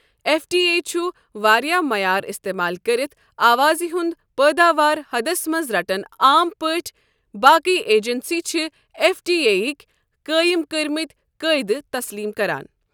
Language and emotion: Kashmiri, neutral